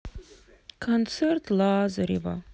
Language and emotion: Russian, sad